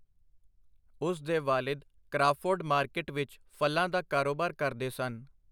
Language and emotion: Punjabi, neutral